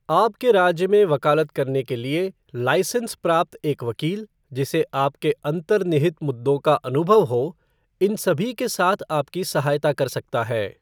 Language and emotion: Hindi, neutral